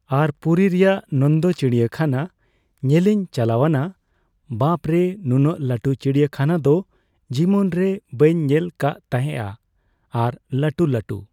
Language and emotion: Santali, neutral